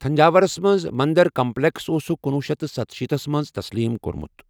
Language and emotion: Kashmiri, neutral